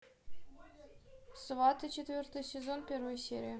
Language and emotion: Russian, neutral